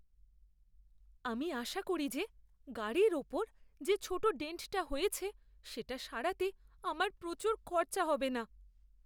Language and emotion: Bengali, fearful